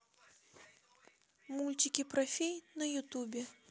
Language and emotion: Russian, neutral